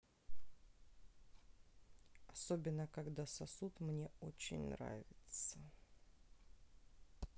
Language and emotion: Russian, neutral